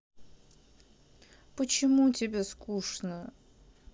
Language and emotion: Russian, sad